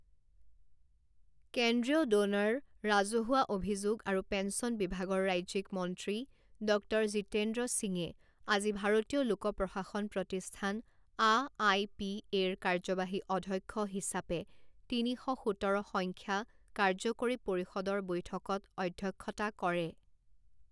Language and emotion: Assamese, neutral